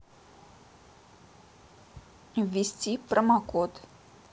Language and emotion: Russian, neutral